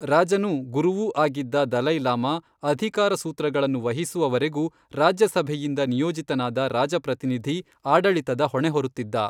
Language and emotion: Kannada, neutral